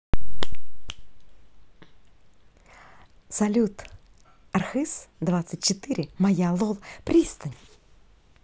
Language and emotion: Russian, positive